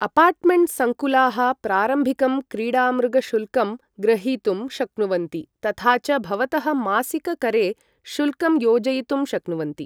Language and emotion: Sanskrit, neutral